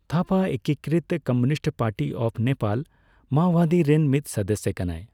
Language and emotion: Santali, neutral